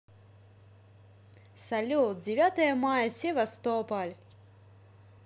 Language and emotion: Russian, positive